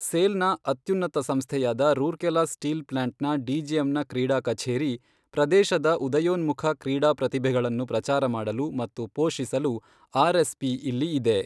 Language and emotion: Kannada, neutral